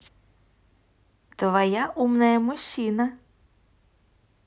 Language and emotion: Russian, positive